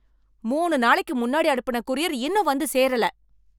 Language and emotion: Tamil, angry